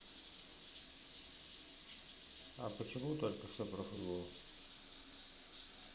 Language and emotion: Russian, neutral